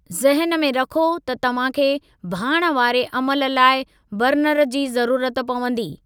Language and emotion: Sindhi, neutral